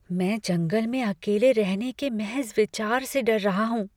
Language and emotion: Hindi, fearful